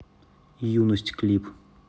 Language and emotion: Russian, neutral